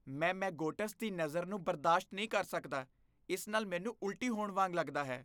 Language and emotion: Punjabi, disgusted